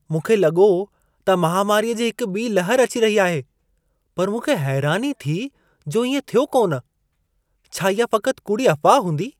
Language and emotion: Sindhi, surprised